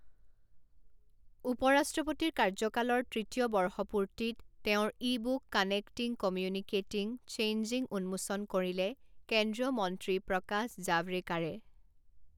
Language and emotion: Assamese, neutral